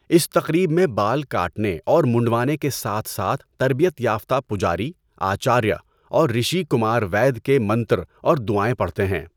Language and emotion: Urdu, neutral